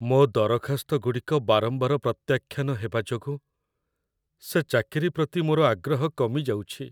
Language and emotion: Odia, sad